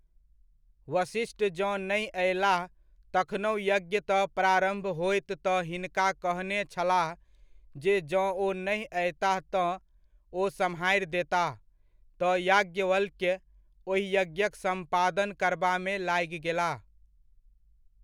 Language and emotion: Maithili, neutral